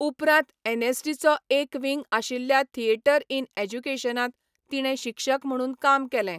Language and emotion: Goan Konkani, neutral